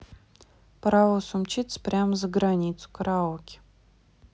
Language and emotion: Russian, neutral